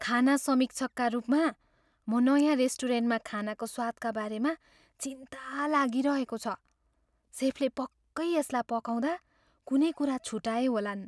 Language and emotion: Nepali, fearful